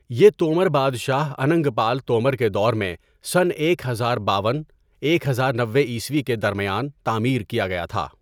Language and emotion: Urdu, neutral